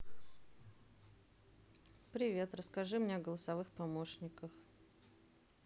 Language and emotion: Russian, neutral